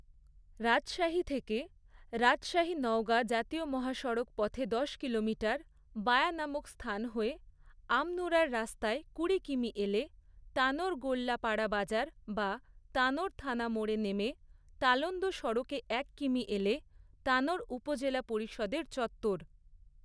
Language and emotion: Bengali, neutral